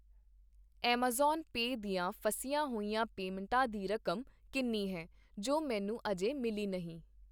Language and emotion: Punjabi, neutral